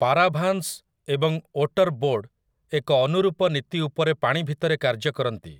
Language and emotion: Odia, neutral